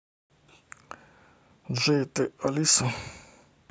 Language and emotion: Russian, neutral